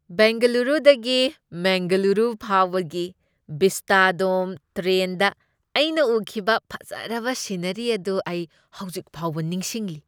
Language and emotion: Manipuri, happy